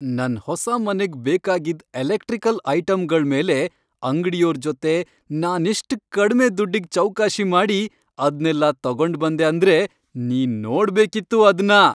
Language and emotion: Kannada, happy